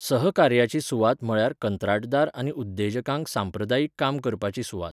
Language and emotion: Goan Konkani, neutral